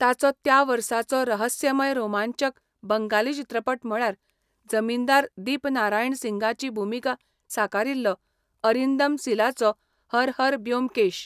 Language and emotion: Goan Konkani, neutral